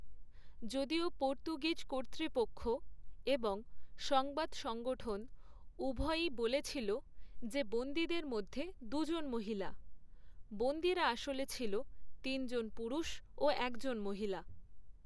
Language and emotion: Bengali, neutral